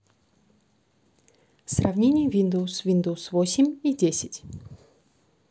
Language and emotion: Russian, neutral